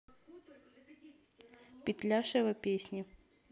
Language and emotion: Russian, neutral